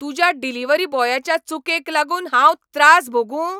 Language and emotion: Goan Konkani, angry